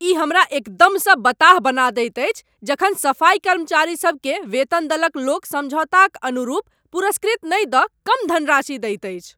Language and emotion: Maithili, angry